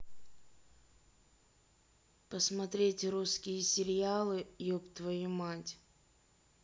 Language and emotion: Russian, neutral